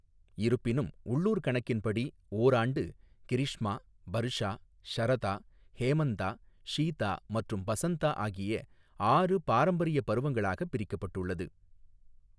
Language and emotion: Tamil, neutral